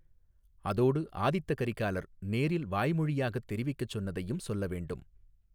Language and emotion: Tamil, neutral